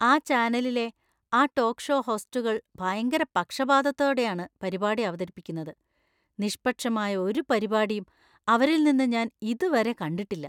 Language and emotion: Malayalam, disgusted